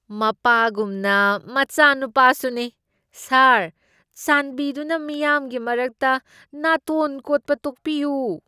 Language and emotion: Manipuri, disgusted